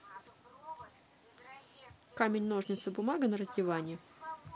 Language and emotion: Russian, neutral